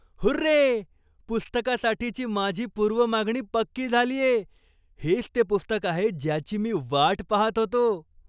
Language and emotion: Marathi, surprised